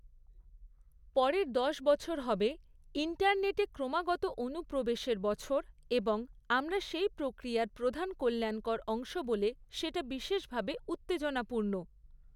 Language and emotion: Bengali, neutral